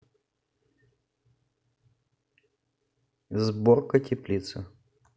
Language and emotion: Russian, neutral